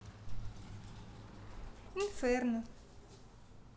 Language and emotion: Russian, neutral